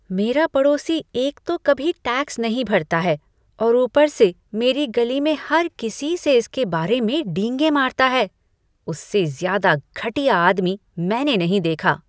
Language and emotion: Hindi, disgusted